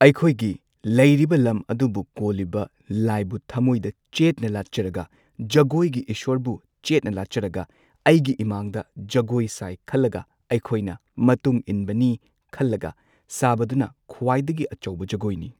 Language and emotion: Manipuri, neutral